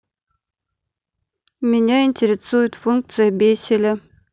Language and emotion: Russian, neutral